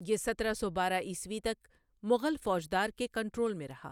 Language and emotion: Urdu, neutral